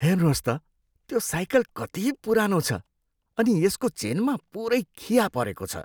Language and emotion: Nepali, disgusted